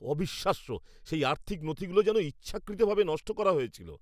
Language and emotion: Bengali, angry